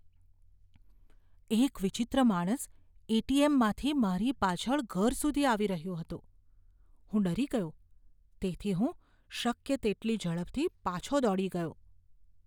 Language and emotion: Gujarati, fearful